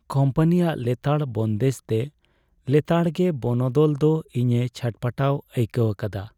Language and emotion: Santali, sad